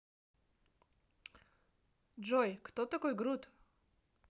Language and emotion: Russian, neutral